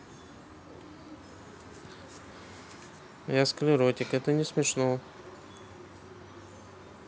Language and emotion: Russian, neutral